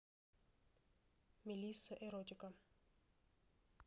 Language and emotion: Russian, neutral